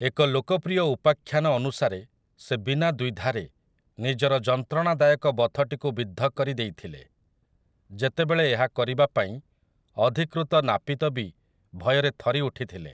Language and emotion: Odia, neutral